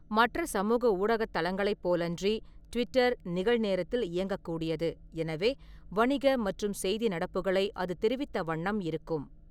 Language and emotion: Tamil, neutral